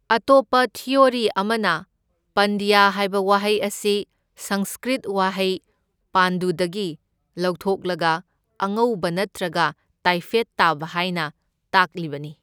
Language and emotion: Manipuri, neutral